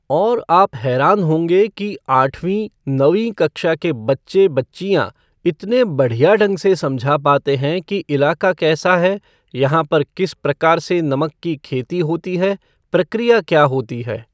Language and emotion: Hindi, neutral